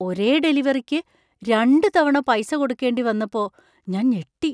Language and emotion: Malayalam, surprised